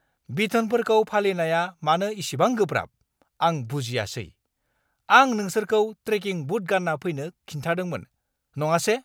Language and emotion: Bodo, angry